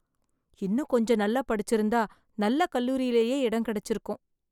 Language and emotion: Tamil, sad